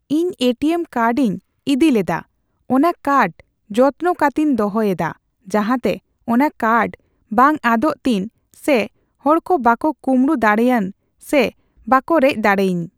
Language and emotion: Santali, neutral